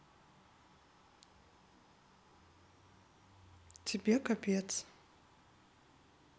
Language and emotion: Russian, neutral